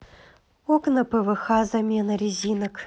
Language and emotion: Russian, neutral